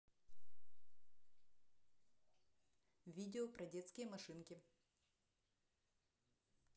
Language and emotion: Russian, neutral